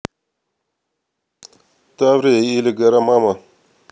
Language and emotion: Russian, neutral